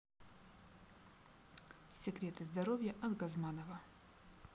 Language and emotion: Russian, neutral